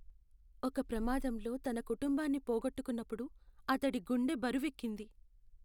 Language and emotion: Telugu, sad